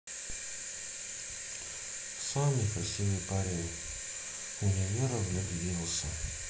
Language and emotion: Russian, sad